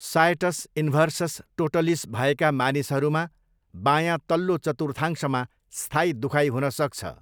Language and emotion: Nepali, neutral